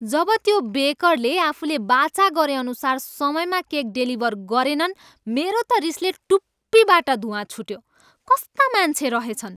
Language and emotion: Nepali, angry